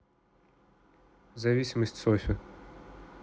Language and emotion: Russian, neutral